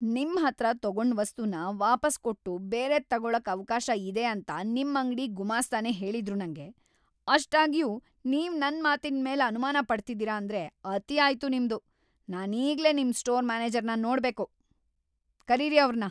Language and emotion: Kannada, angry